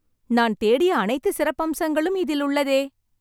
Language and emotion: Tamil, happy